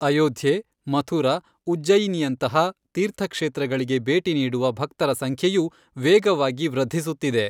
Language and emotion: Kannada, neutral